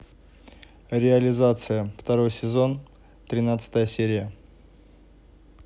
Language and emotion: Russian, neutral